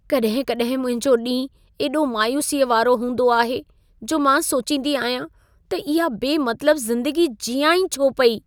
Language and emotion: Sindhi, sad